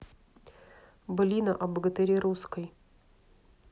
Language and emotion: Russian, neutral